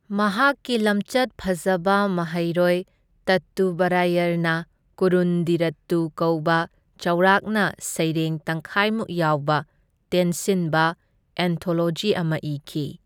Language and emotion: Manipuri, neutral